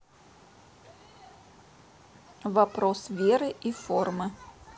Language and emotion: Russian, neutral